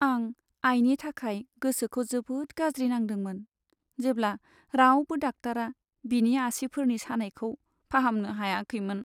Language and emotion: Bodo, sad